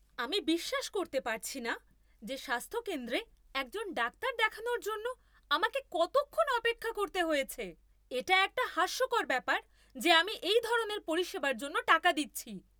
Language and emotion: Bengali, angry